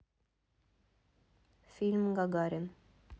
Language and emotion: Russian, neutral